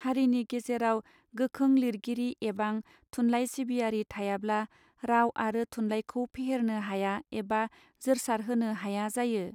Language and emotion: Bodo, neutral